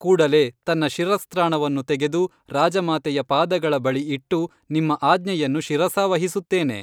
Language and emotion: Kannada, neutral